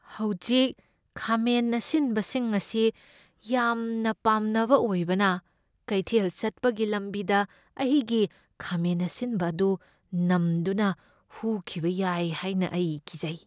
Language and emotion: Manipuri, fearful